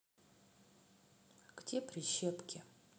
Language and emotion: Russian, neutral